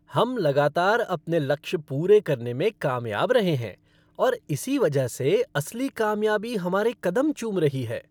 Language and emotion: Hindi, happy